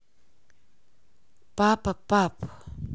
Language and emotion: Russian, neutral